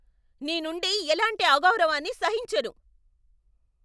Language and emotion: Telugu, angry